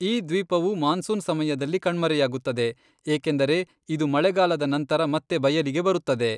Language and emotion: Kannada, neutral